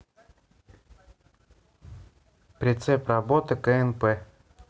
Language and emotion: Russian, neutral